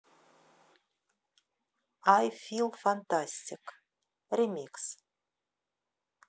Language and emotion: Russian, neutral